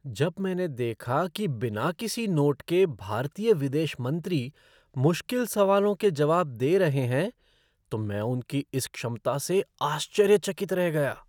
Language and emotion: Hindi, surprised